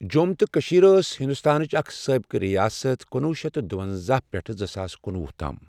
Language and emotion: Kashmiri, neutral